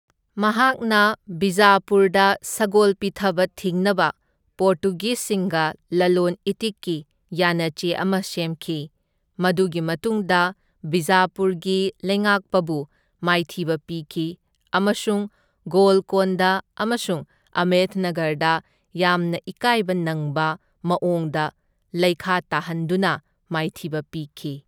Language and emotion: Manipuri, neutral